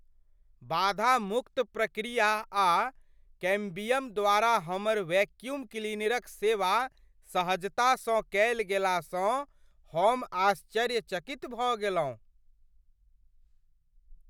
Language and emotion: Maithili, surprised